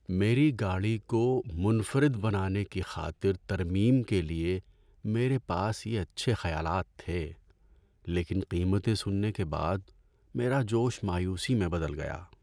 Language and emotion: Urdu, sad